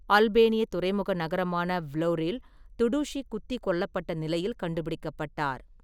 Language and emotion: Tamil, neutral